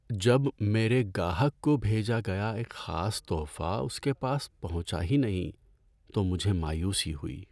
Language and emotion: Urdu, sad